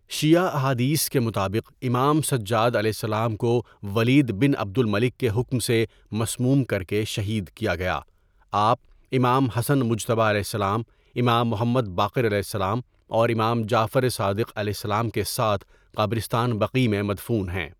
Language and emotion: Urdu, neutral